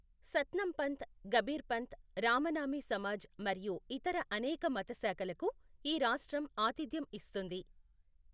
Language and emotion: Telugu, neutral